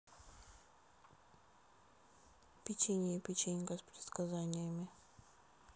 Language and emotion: Russian, neutral